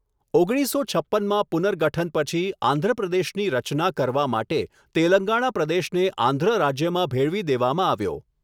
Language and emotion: Gujarati, neutral